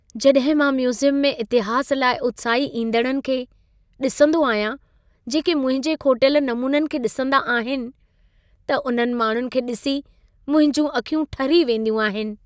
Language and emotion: Sindhi, happy